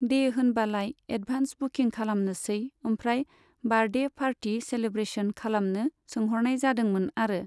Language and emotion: Bodo, neutral